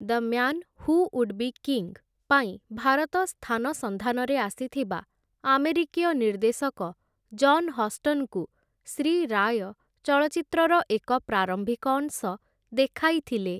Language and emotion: Odia, neutral